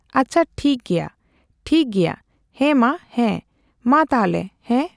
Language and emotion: Santali, neutral